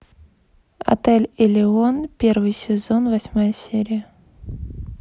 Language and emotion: Russian, neutral